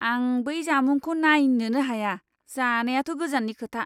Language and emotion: Bodo, disgusted